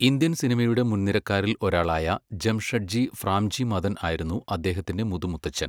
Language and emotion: Malayalam, neutral